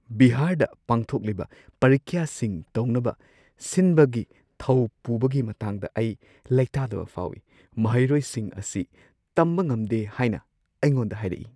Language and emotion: Manipuri, fearful